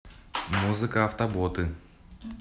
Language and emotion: Russian, positive